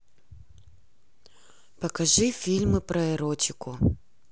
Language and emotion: Russian, neutral